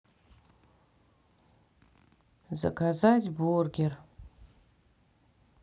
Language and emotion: Russian, sad